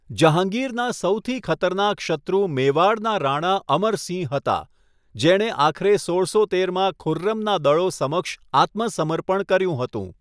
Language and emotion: Gujarati, neutral